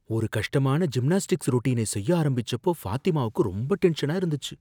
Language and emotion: Tamil, fearful